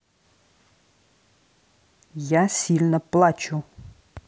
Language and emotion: Russian, angry